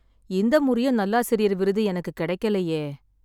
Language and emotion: Tamil, sad